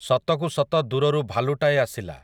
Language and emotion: Odia, neutral